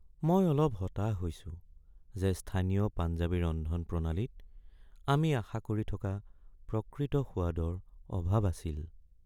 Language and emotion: Assamese, sad